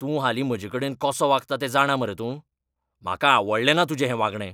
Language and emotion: Goan Konkani, angry